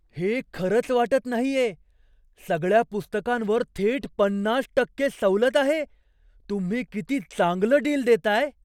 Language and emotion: Marathi, surprised